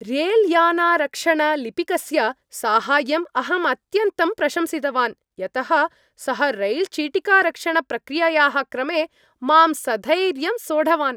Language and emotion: Sanskrit, happy